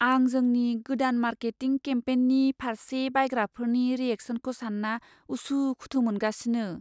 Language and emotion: Bodo, fearful